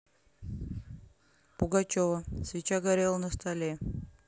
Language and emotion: Russian, neutral